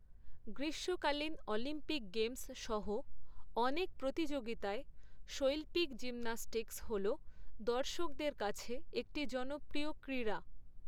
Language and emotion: Bengali, neutral